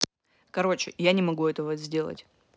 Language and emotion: Russian, neutral